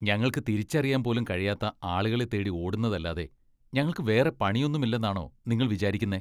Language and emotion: Malayalam, disgusted